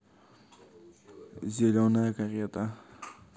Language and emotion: Russian, neutral